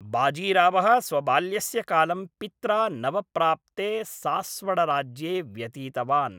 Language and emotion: Sanskrit, neutral